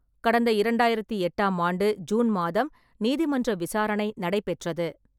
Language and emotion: Tamil, neutral